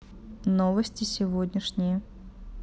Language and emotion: Russian, neutral